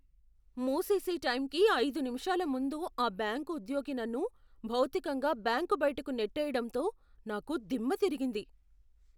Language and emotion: Telugu, surprised